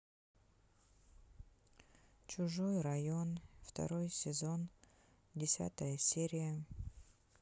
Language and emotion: Russian, sad